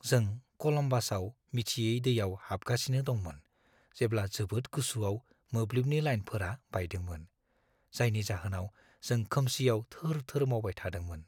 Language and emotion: Bodo, fearful